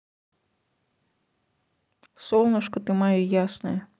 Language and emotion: Russian, neutral